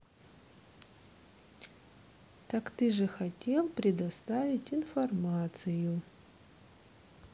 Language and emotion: Russian, neutral